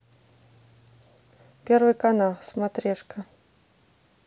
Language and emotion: Russian, neutral